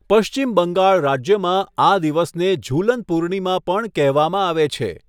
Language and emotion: Gujarati, neutral